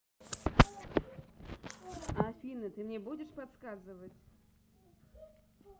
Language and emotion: Russian, neutral